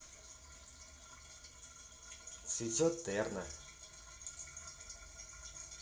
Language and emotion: Russian, positive